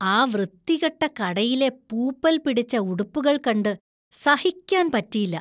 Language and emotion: Malayalam, disgusted